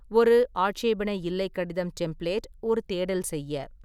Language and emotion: Tamil, neutral